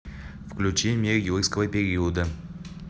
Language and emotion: Russian, neutral